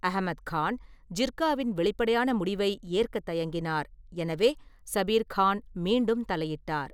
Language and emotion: Tamil, neutral